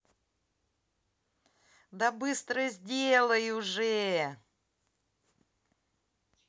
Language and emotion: Russian, positive